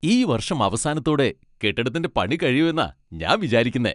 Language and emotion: Malayalam, happy